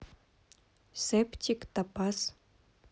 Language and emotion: Russian, neutral